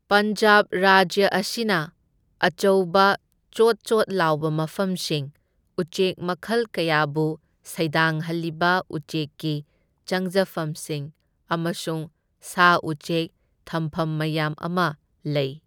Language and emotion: Manipuri, neutral